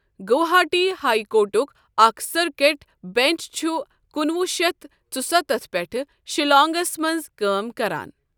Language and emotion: Kashmiri, neutral